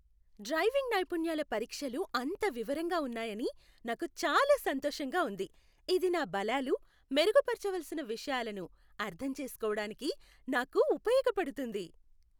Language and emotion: Telugu, happy